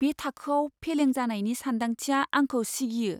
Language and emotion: Bodo, fearful